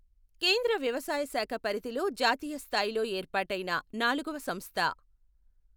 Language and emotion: Telugu, neutral